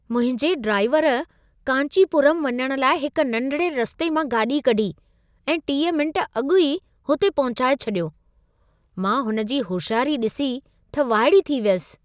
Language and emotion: Sindhi, surprised